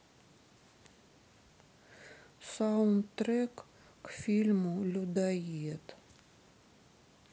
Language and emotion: Russian, sad